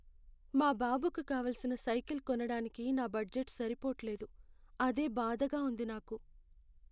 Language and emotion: Telugu, sad